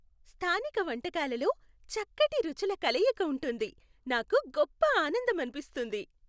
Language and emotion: Telugu, happy